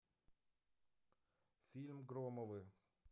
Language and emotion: Russian, neutral